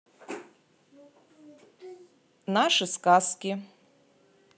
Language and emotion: Russian, neutral